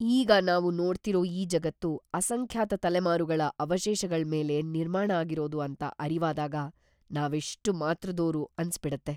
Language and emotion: Kannada, fearful